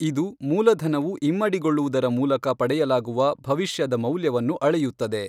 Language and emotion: Kannada, neutral